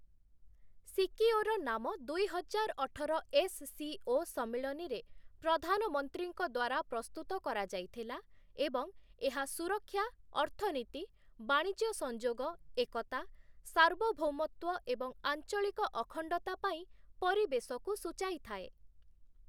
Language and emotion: Odia, neutral